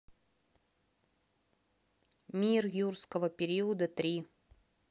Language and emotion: Russian, neutral